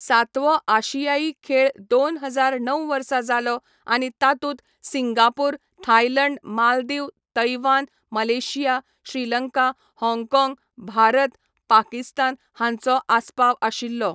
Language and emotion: Goan Konkani, neutral